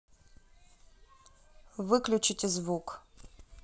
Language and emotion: Russian, neutral